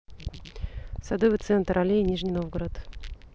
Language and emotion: Russian, neutral